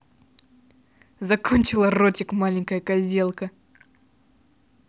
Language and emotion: Russian, angry